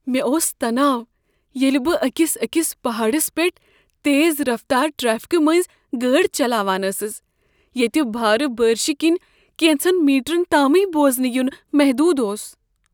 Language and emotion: Kashmiri, fearful